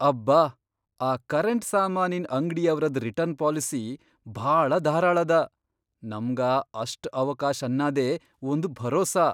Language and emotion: Kannada, surprised